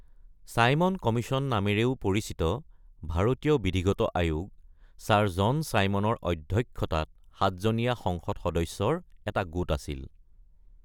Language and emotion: Assamese, neutral